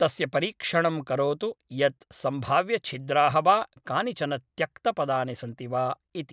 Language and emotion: Sanskrit, neutral